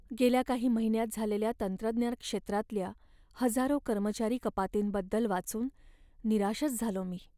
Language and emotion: Marathi, sad